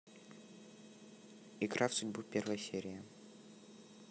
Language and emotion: Russian, neutral